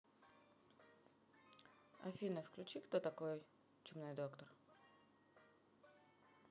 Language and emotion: Russian, neutral